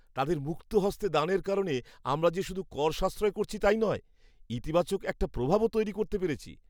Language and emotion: Bengali, happy